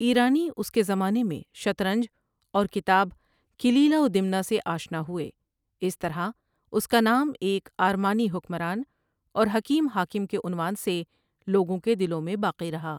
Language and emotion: Urdu, neutral